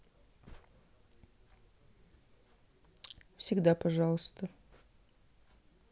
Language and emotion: Russian, neutral